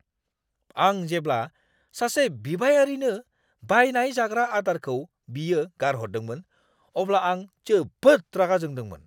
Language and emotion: Bodo, angry